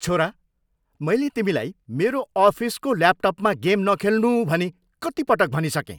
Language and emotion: Nepali, angry